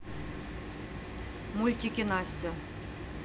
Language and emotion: Russian, neutral